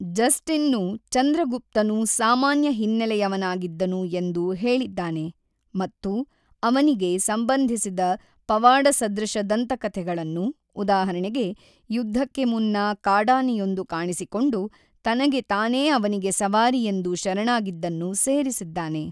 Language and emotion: Kannada, neutral